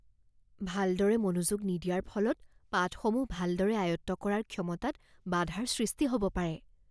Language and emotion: Assamese, fearful